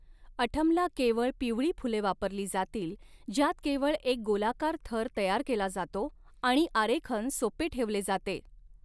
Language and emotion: Marathi, neutral